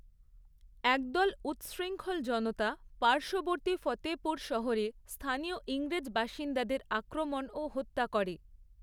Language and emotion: Bengali, neutral